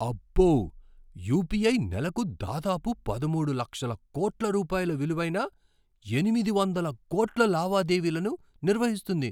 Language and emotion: Telugu, surprised